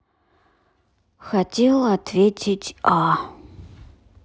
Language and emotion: Russian, sad